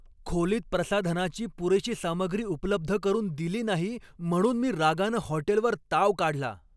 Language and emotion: Marathi, angry